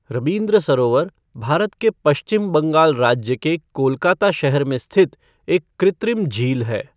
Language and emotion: Hindi, neutral